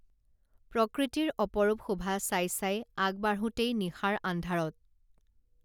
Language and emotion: Assamese, neutral